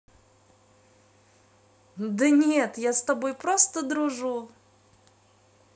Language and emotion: Russian, positive